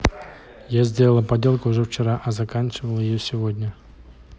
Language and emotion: Russian, neutral